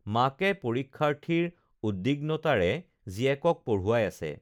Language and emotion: Assamese, neutral